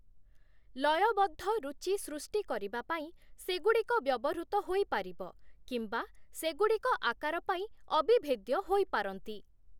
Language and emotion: Odia, neutral